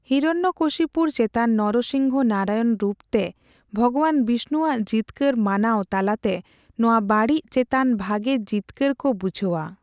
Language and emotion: Santali, neutral